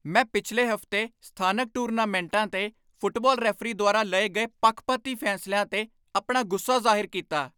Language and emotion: Punjabi, angry